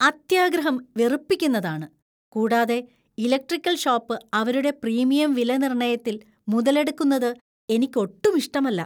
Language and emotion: Malayalam, disgusted